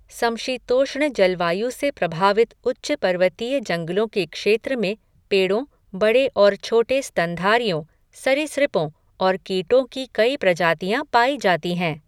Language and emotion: Hindi, neutral